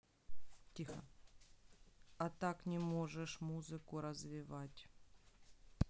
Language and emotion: Russian, neutral